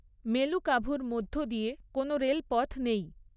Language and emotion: Bengali, neutral